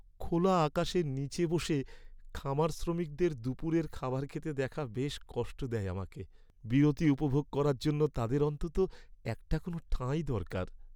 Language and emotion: Bengali, sad